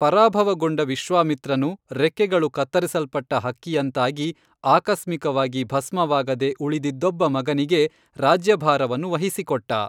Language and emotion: Kannada, neutral